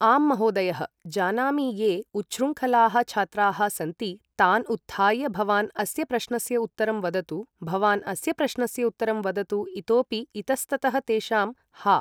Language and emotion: Sanskrit, neutral